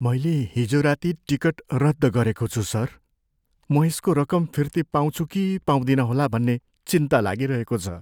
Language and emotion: Nepali, fearful